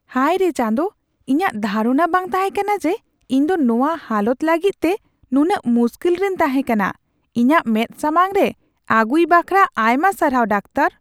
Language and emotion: Santali, surprised